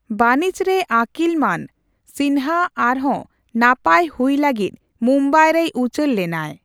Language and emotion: Santali, neutral